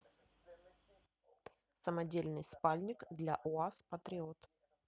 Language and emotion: Russian, neutral